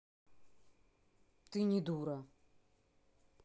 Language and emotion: Russian, neutral